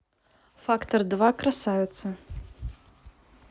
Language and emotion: Russian, neutral